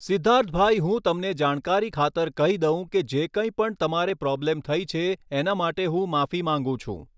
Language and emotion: Gujarati, neutral